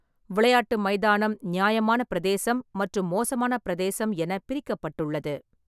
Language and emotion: Tamil, neutral